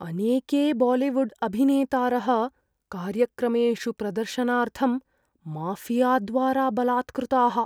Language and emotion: Sanskrit, fearful